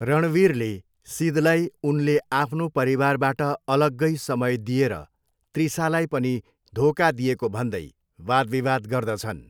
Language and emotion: Nepali, neutral